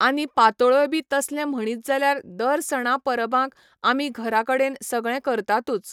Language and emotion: Goan Konkani, neutral